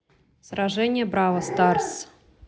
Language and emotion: Russian, neutral